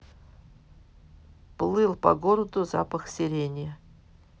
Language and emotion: Russian, neutral